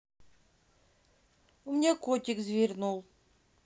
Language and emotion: Russian, sad